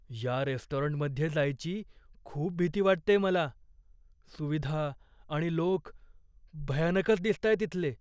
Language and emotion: Marathi, fearful